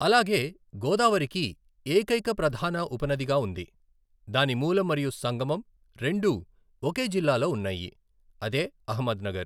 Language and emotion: Telugu, neutral